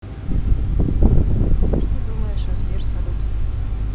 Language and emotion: Russian, neutral